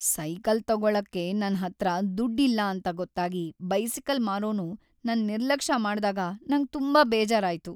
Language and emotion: Kannada, sad